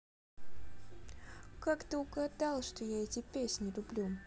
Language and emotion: Russian, sad